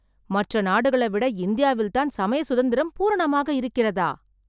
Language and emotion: Tamil, surprised